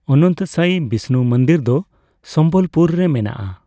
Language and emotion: Santali, neutral